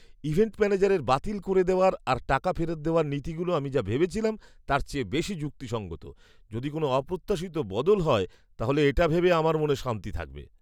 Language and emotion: Bengali, surprised